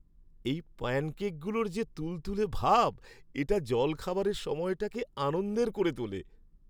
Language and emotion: Bengali, happy